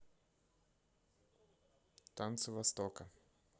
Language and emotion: Russian, neutral